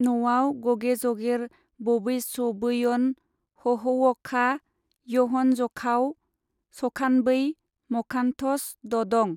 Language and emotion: Bodo, neutral